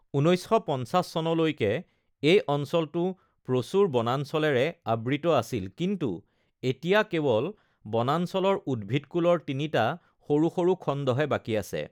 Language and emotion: Assamese, neutral